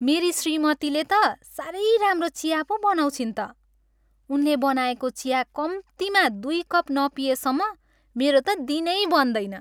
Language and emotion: Nepali, happy